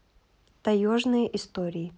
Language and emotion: Russian, neutral